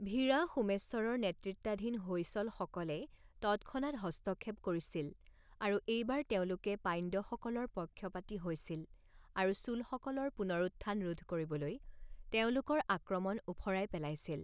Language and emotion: Assamese, neutral